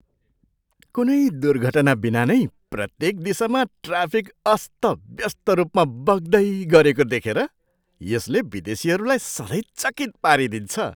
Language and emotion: Nepali, surprised